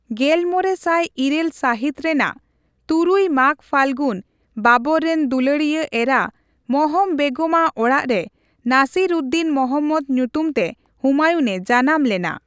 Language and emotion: Santali, neutral